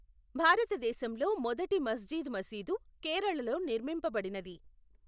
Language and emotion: Telugu, neutral